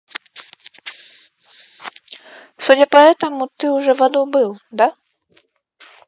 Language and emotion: Russian, neutral